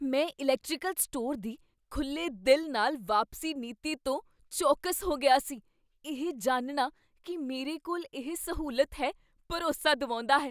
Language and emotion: Punjabi, surprised